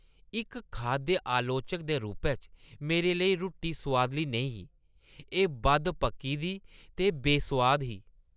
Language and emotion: Dogri, disgusted